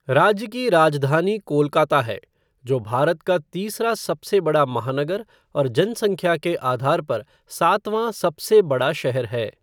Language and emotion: Hindi, neutral